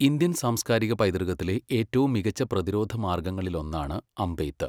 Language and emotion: Malayalam, neutral